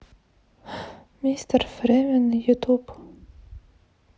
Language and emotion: Russian, sad